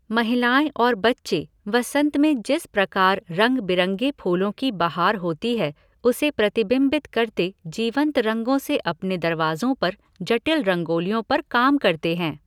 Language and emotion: Hindi, neutral